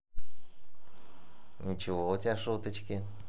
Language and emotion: Russian, positive